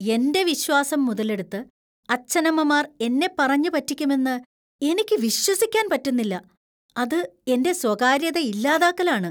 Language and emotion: Malayalam, disgusted